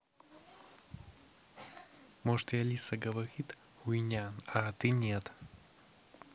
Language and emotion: Russian, neutral